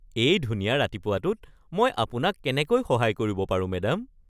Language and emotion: Assamese, happy